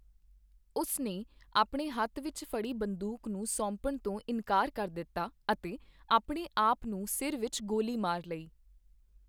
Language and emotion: Punjabi, neutral